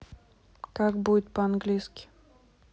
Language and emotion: Russian, neutral